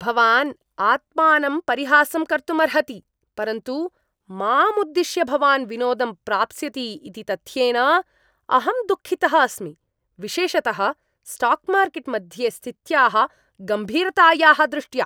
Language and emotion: Sanskrit, disgusted